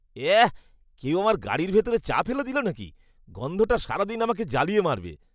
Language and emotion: Bengali, disgusted